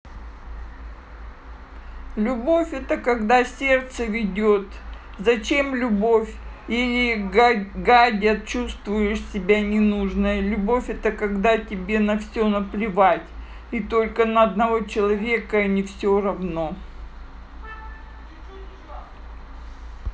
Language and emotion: Russian, sad